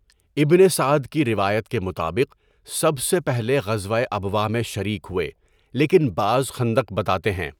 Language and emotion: Urdu, neutral